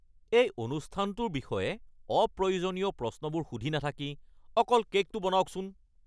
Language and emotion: Assamese, angry